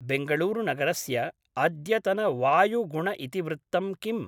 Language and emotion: Sanskrit, neutral